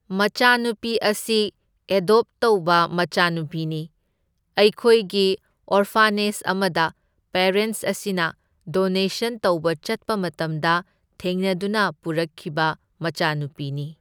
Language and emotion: Manipuri, neutral